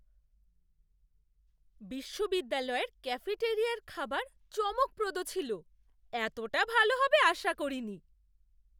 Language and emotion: Bengali, surprised